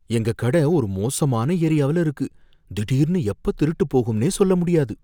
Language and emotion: Tamil, fearful